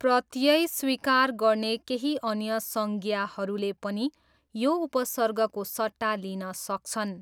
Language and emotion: Nepali, neutral